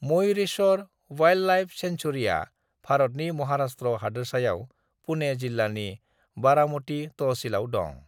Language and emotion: Bodo, neutral